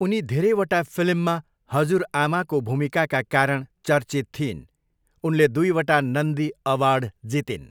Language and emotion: Nepali, neutral